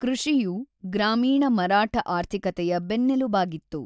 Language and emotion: Kannada, neutral